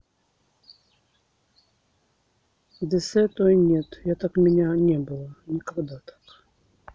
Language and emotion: Russian, sad